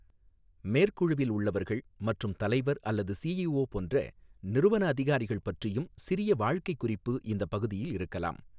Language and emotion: Tamil, neutral